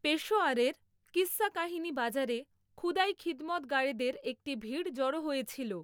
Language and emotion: Bengali, neutral